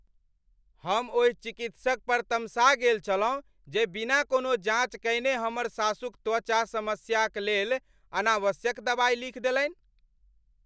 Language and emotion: Maithili, angry